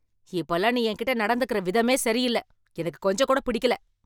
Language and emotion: Tamil, angry